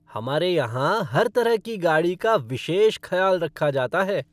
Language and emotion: Hindi, happy